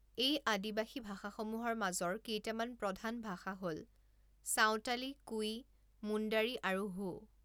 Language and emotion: Assamese, neutral